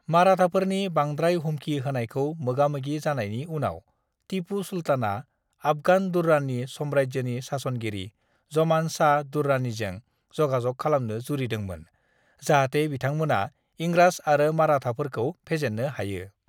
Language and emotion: Bodo, neutral